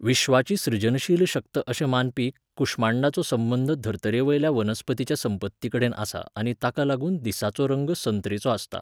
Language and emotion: Goan Konkani, neutral